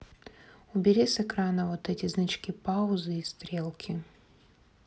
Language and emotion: Russian, neutral